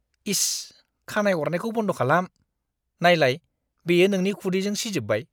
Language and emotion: Bodo, disgusted